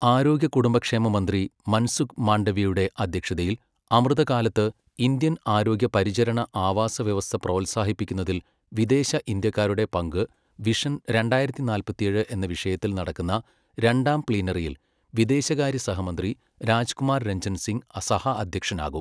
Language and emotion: Malayalam, neutral